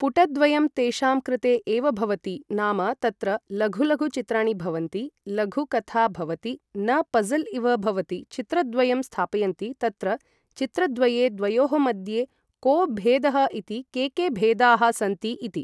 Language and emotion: Sanskrit, neutral